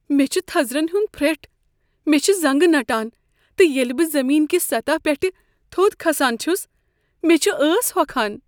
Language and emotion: Kashmiri, fearful